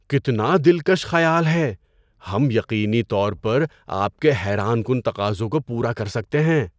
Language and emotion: Urdu, surprised